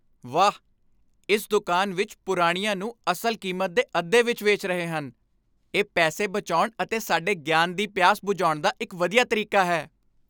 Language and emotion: Punjabi, happy